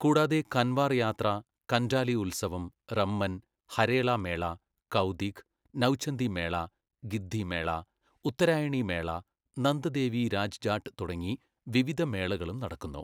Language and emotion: Malayalam, neutral